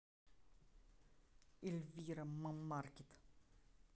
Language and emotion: Russian, angry